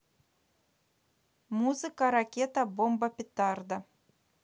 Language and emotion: Russian, neutral